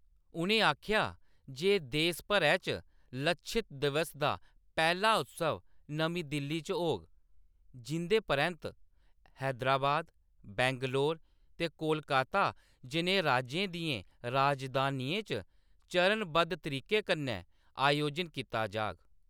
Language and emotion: Dogri, neutral